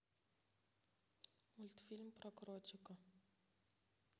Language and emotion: Russian, neutral